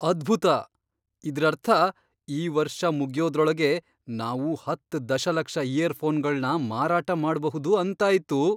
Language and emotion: Kannada, surprised